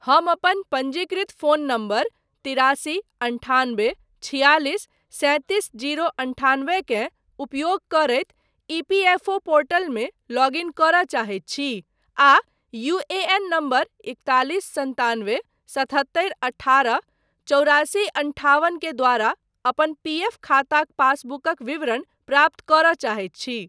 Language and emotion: Maithili, neutral